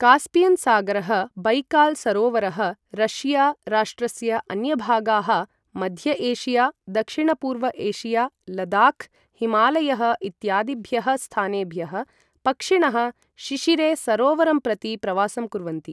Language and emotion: Sanskrit, neutral